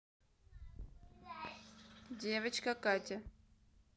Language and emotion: Russian, neutral